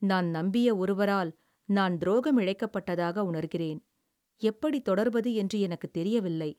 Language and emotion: Tamil, sad